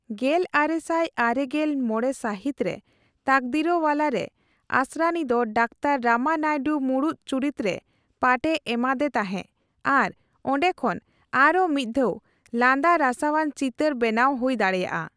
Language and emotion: Santali, neutral